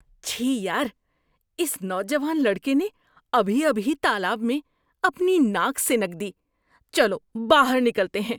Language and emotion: Urdu, disgusted